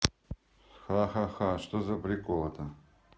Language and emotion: Russian, neutral